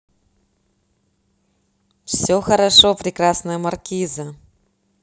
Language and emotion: Russian, positive